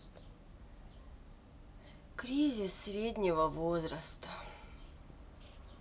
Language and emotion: Russian, sad